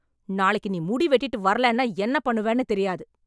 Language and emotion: Tamil, angry